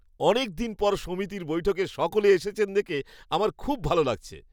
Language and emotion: Bengali, happy